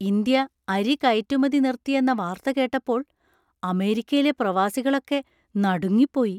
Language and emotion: Malayalam, surprised